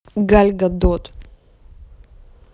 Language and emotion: Russian, angry